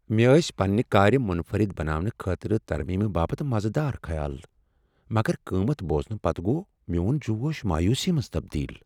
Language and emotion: Kashmiri, sad